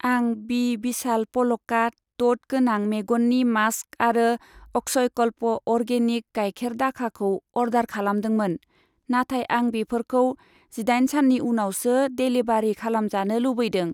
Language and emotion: Bodo, neutral